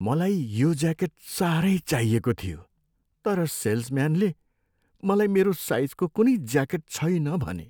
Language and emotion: Nepali, sad